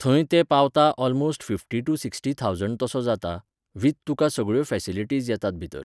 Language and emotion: Goan Konkani, neutral